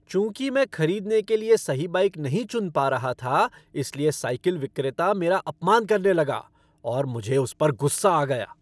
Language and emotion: Hindi, angry